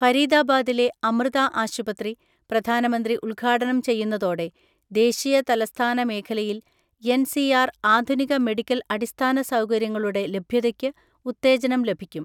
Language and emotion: Malayalam, neutral